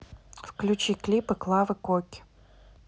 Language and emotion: Russian, neutral